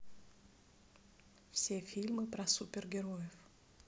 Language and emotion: Russian, neutral